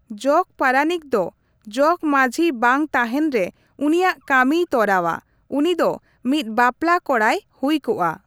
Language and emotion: Santali, neutral